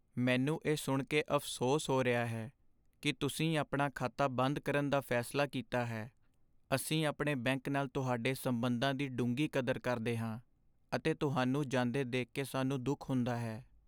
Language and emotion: Punjabi, sad